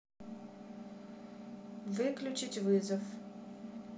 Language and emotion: Russian, neutral